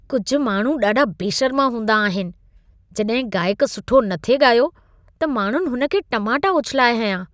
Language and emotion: Sindhi, disgusted